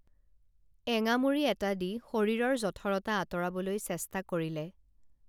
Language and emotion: Assamese, neutral